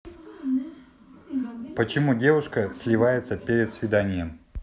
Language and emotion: Russian, neutral